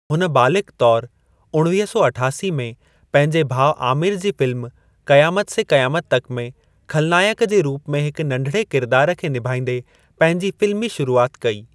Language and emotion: Sindhi, neutral